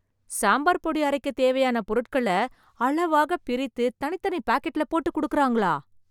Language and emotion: Tamil, surprised